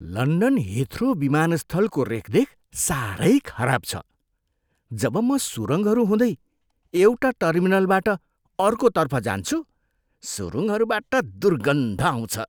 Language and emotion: Nepali, disgusted